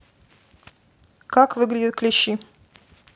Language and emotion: Russian, neutral